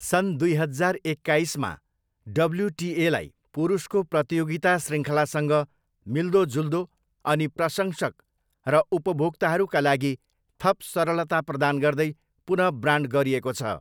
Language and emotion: Nepali, neutral